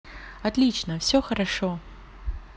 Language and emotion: Russian, positive